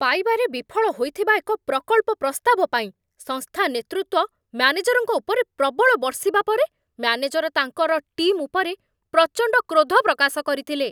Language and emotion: Odia, angry